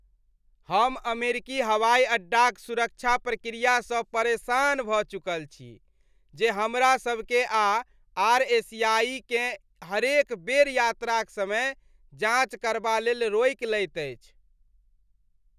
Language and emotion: Maithili, disgusted